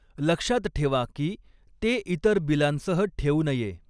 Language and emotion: Marathi, neutral